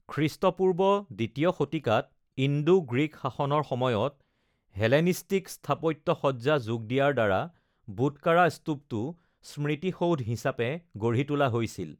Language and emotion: Assamese, neutral